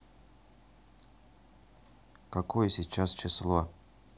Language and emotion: Russian, neutral